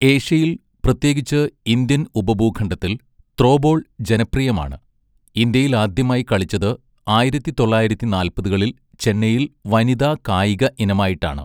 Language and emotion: Malayalam, neutral